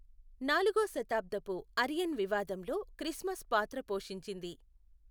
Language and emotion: Telugu, neutral